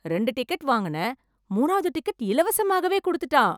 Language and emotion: Tamil, surprised